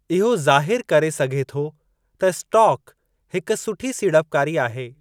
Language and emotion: Sindhi, neutral